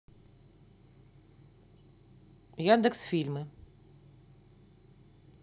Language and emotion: Russian, neutral